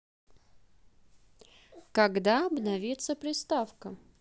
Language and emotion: Russian, neutral